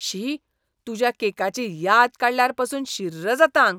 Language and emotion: Goan Konkani, disgusted